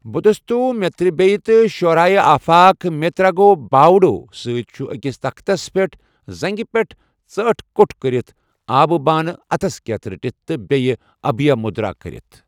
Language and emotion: Kashmiri, neutral